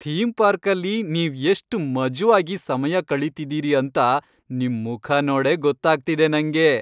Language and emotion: Kannada, happy